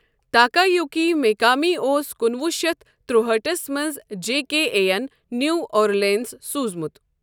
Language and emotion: Kashmiri, neutral